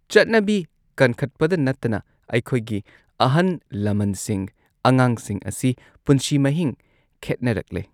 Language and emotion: Manipuri, neutral